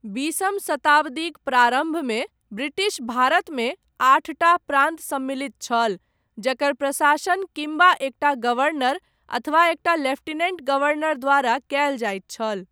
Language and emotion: Maithili, neutral